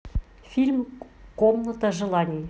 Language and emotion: Russian, neutral